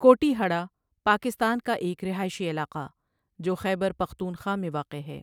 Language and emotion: Urdu, neutral